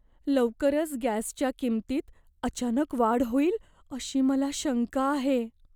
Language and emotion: Marathi, fearful